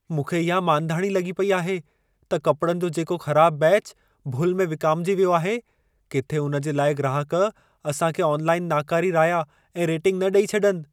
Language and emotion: Sindhi, fearful